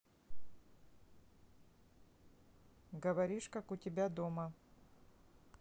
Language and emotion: Russian, neutral